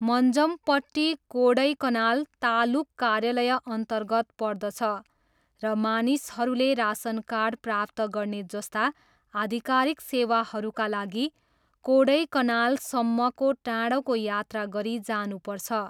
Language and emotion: Nepali, neutral